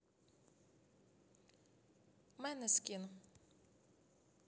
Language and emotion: Russian, neutral